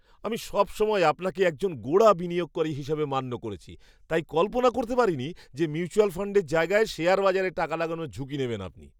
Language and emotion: Bengali, surprised